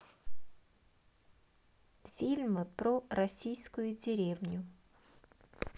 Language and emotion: Russian, neutral